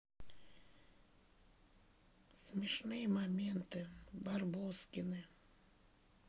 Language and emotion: Russian, sad